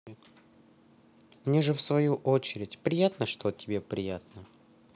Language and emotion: Russian, neutral